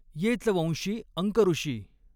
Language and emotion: Marathi, neutral